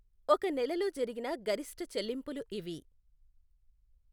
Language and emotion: Telugu, neutral